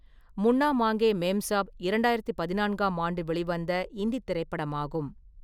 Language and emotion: Tamil, neutral